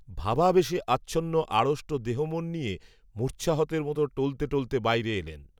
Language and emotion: Bengali, neutral